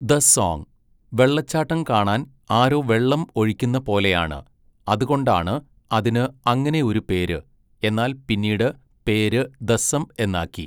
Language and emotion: Malayalam, neutral